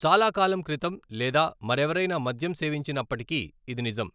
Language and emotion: Telugu, neutral